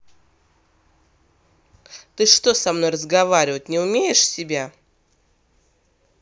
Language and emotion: Russian, angry